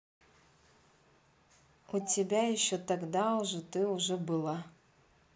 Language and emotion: Russian, neutral